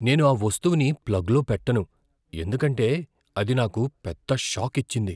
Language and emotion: Telugu, fearful